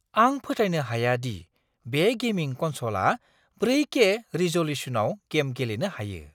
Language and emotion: Bodo, surprised